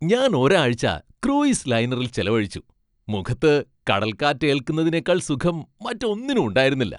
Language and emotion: Malayalam, happy